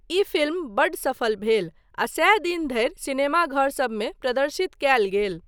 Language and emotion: Maithili, neutral